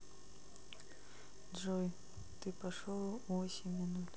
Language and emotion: Russian, neutral